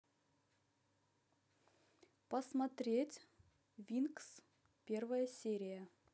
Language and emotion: Russian, neutral